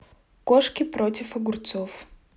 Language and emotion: Russian, neutral